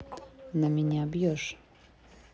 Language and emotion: Russian, neutral